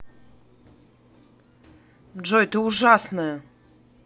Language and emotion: Russian, angry